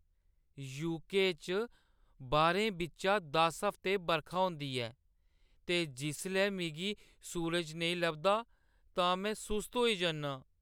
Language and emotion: Dogri, sad